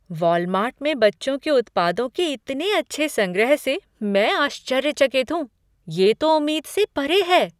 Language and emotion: Hindi, surprised